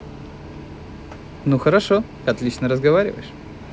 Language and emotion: Russian, positive